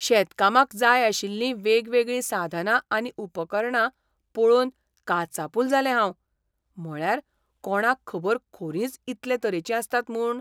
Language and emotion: Goan Konkani, surprised